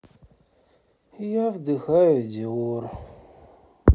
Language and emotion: Russian, sad